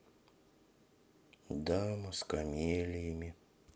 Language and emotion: Russian, sad